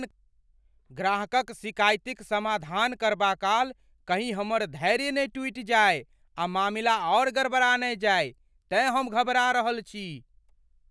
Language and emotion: Maithili, fearful